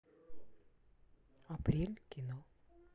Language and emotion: Russian, neutral